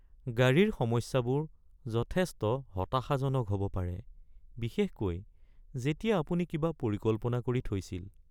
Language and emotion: Assamese, sad